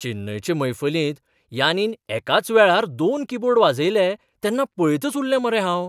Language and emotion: Goan Konkani, surprised